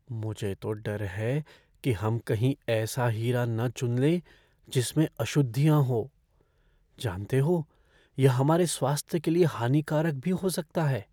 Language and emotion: Hindi, fearful